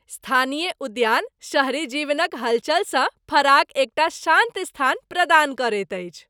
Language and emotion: Maithili, happy